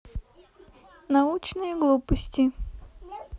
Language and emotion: Russian, neutral